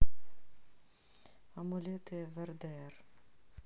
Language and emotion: Russian, neutral